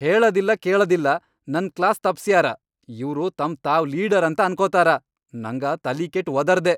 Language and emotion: Kannada, angry